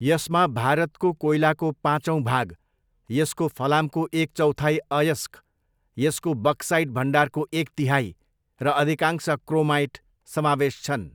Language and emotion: Nepali, neutral